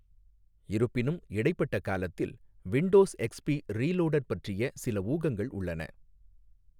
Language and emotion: Tamil, neutral